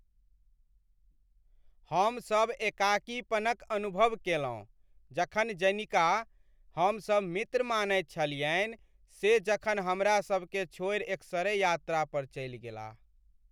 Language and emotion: Maithili, sad